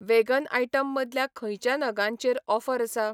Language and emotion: Goan Konkani, neutral